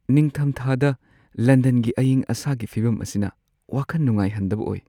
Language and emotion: Manipuri, sad